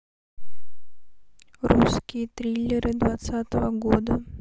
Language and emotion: Russian, neutral